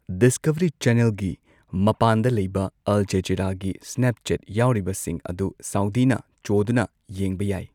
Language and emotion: Manipuri, neutral